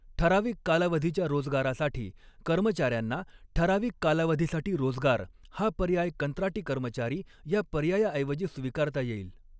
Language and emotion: Marathi, neutral